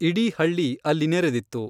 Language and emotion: Kannada, neutral